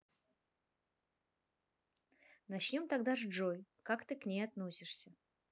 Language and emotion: Russian, neutral